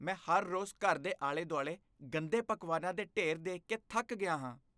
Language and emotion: Punjabi, disgusted